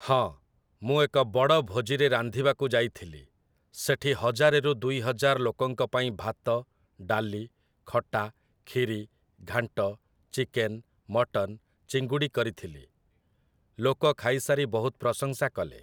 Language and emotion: Odia, neutral